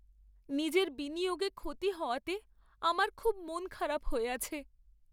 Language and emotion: Bengali, sad